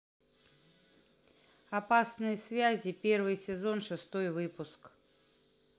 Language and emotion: Russian, neutral